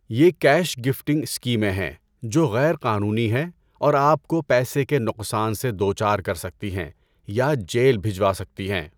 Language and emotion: Urdu, neutral